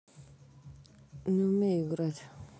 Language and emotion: Russian, neutral